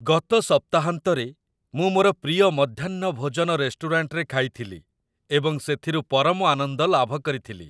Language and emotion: Odia, happy